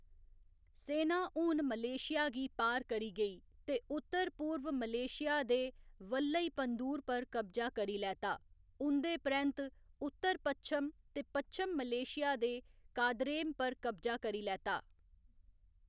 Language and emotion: Dogri, neutral